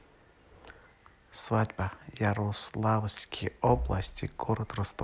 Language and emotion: Russian, neutral